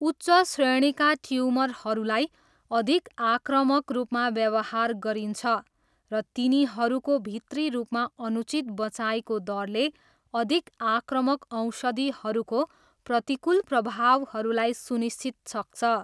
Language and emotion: Nepali, neutral